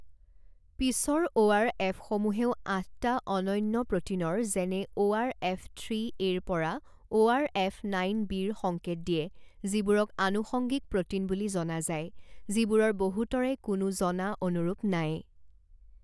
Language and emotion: Assamese, neutral